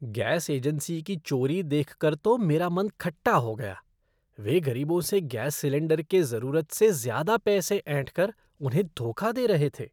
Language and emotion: Hindi, disgusted